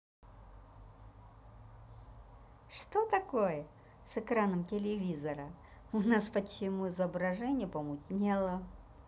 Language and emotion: Russian, positive